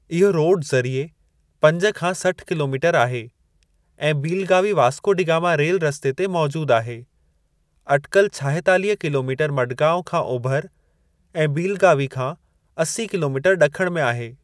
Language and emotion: Sindhi, neutral